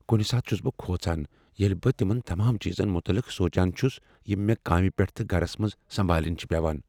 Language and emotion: Kashmiri, fearful